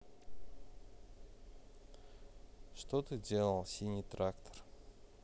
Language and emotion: Russian, neutral